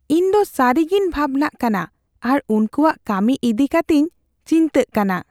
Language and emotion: Santali, fearful